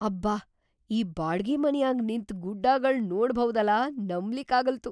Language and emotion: Kannada, surprised